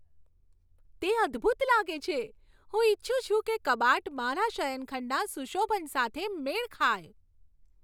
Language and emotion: Gujarati, happy